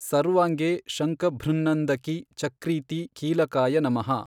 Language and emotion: Kannada, neutral